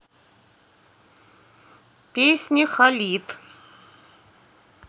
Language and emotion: Russian, neutral